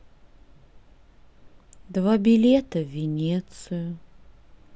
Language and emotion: Russian, sad